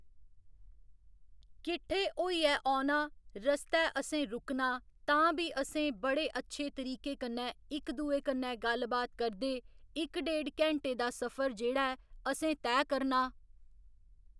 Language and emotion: Dogri, neutral